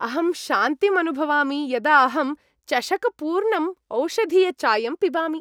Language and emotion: Sanskrit, happy